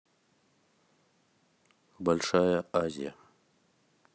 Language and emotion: Russian, neutral